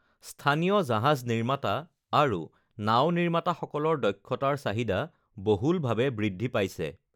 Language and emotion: Assamese, neutral